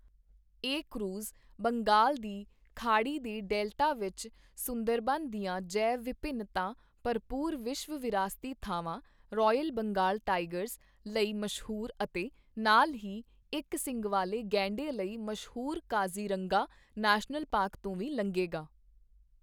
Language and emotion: Punjabi, neutral